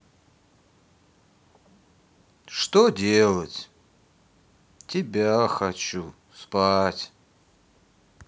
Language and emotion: Russian, sad